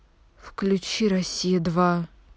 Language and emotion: Russian, neutral